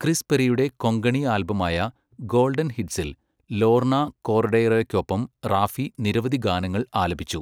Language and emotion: Malayalam, neutral